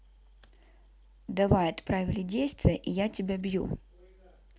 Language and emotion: Russian, neutral